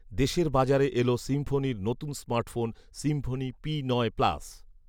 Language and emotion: Bengali, neutral